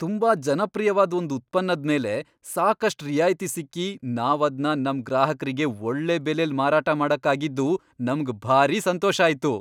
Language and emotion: Kannada, happy